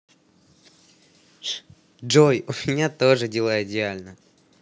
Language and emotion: Russian, positive